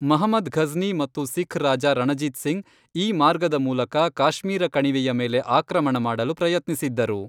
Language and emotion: Kannada, neutral